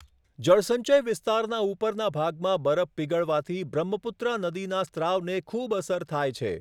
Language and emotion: Gujarati, neutral